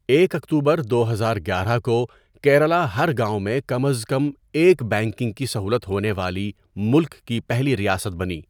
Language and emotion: Urdu, neutral